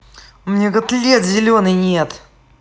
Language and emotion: Russian, angry